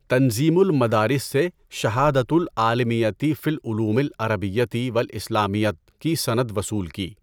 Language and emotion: Urdu, neutral